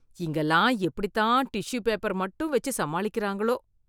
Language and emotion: Tamil, disgusted